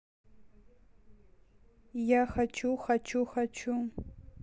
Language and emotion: Russian, neutral